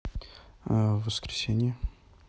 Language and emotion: Russian, neutral